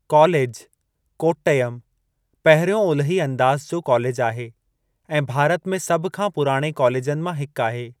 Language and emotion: Sindhi, neutral